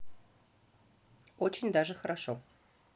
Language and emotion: Russian, positive